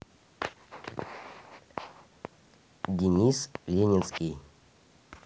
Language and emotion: Russian, neutral